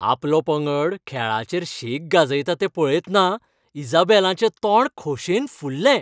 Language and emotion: Goan Konkani, happy